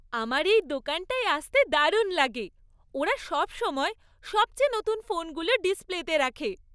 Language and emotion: Bengali, happy